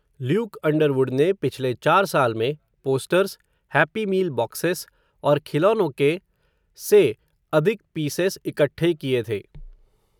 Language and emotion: Hindi, neutral